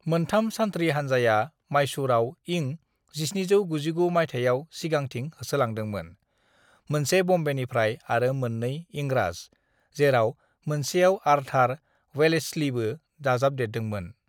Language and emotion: Bodo, neutral